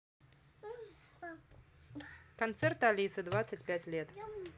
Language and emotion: Russian, neutral